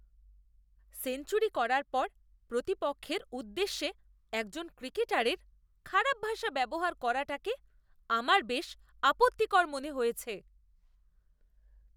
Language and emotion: Bengali, disgusted